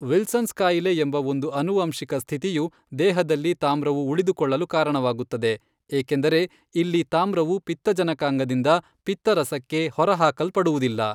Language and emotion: Kannada, neutral